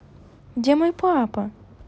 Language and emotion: Russian, neutral